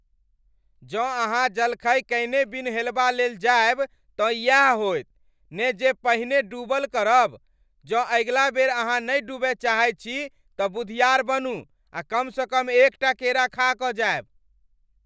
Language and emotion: Maithili, angry